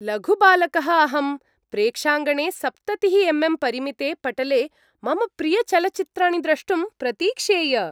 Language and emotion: Sanskrit, happy